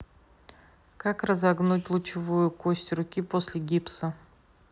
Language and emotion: Russian, neutral